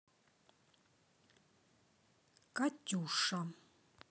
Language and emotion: Russian, neutral